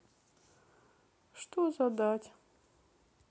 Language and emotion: Russian, sad